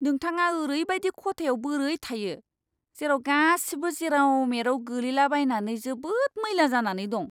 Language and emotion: Bodo, disgusted